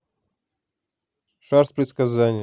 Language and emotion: Russian, neutral